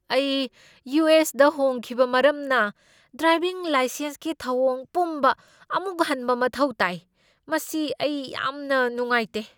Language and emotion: Manipuri, angry